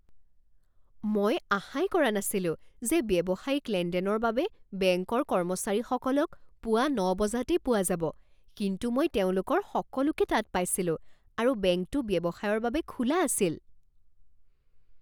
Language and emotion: Assamese, surprised